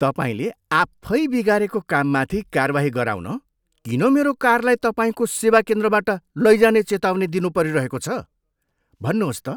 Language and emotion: Nepali, disgusted